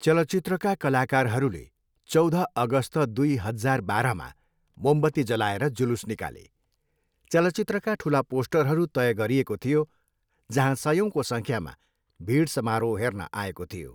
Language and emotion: Nepali, neutral